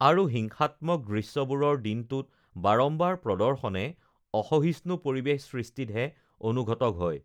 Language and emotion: Assamese, neutral